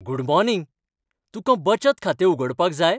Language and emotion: Goan Konkani, happy